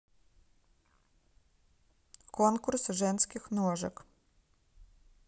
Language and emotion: Russian, neutral